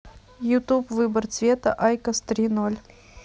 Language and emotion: Russian, neutral